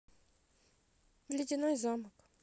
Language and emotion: Russian, neutral